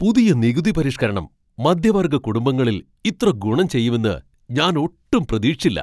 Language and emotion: Malayalam, surprised